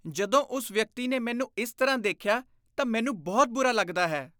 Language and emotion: Punjabi, disgusted